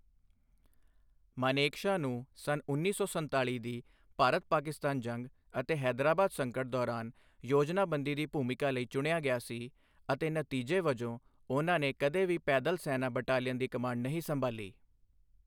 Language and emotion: Punjabi, neutral